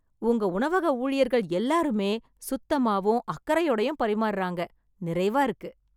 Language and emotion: Tamil, happy